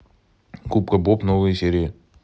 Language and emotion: Russian, neutral